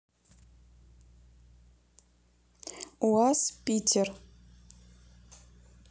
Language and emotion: Russian, neutral